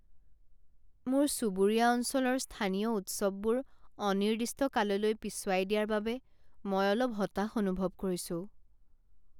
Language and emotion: Assamese, sad